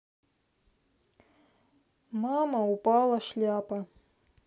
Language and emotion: Russian, sad